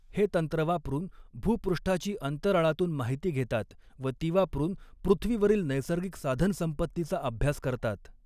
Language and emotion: Marathi, neutral